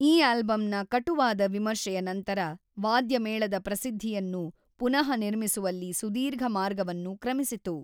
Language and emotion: Kannada, neutral